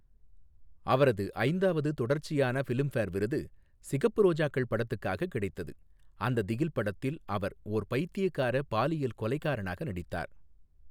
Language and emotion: Tamil, neutral